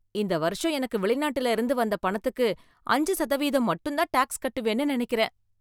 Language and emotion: Tamil, happy